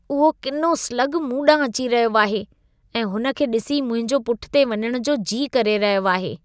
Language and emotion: Sindhi, disgusted